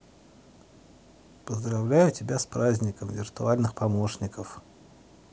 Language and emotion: Russian, positive